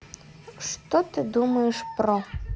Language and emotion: Russian, neutral